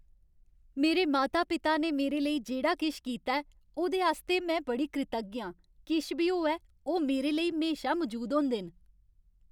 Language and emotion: Dogri, happy